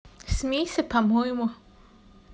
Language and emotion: Russian, neutral